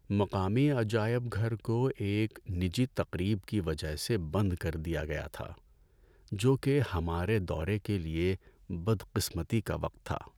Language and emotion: Urdu, sad